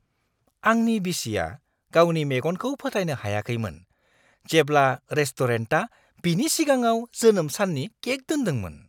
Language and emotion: Bodo, surprised